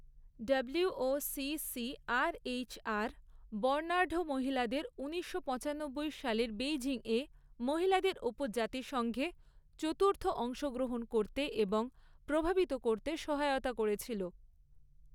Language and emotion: Bengali, neutral